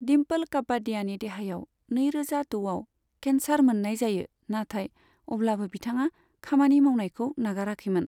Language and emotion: Bodo, neutral